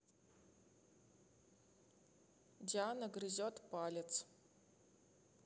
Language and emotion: Russian, neutral